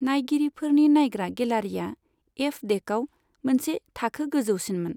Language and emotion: Bodo, neutral